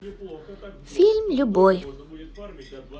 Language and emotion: Russian, positive